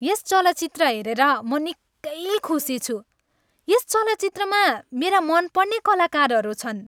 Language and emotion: Nepali, happy